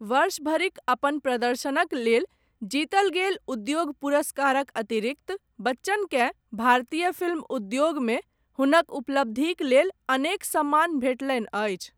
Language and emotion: Maithili, neutral